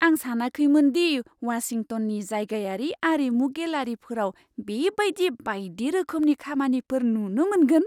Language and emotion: Bodo, surprised